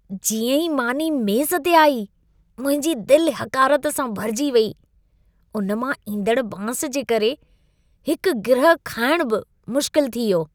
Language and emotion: Sindhi, disgusted